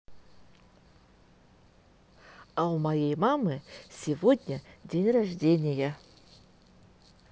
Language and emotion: Russian, positive